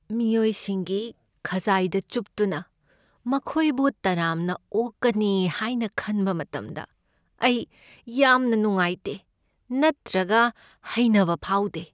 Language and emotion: Manipuri, sad